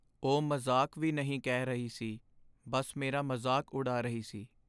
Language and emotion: Punjabi, sad